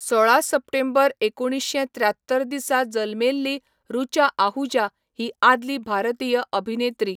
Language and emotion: Goan Konkani, neutral